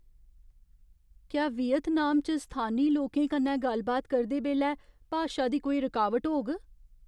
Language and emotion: Dogri, fearful